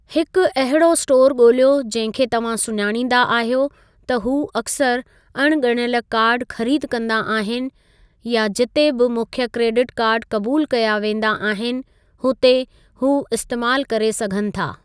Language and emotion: Sindhi, neutral